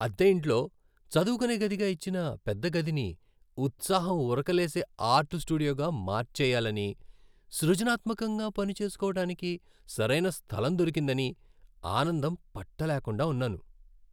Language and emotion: Telugu, happy